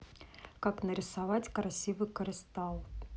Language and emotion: Russian, neutral